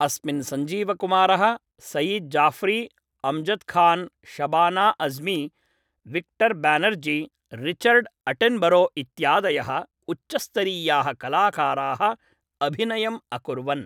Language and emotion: Sanskrit, neutral